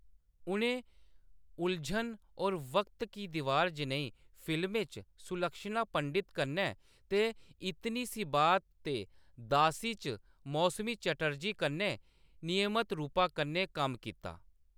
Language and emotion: Dogri, neutral